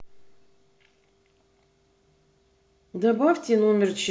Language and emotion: Russian, neutral